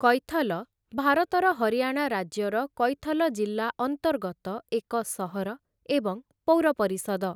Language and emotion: Odia, neutral